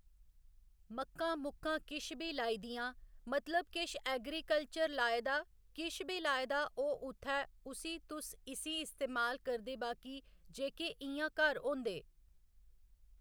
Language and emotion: Dogri, neutral